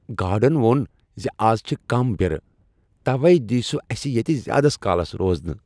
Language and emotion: Kashmiri, happy